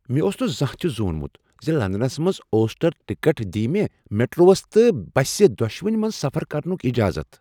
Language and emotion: Kashmiri, surprised